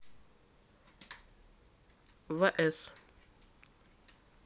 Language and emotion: Russian, neutral